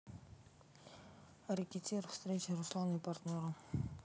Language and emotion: Russian, neutral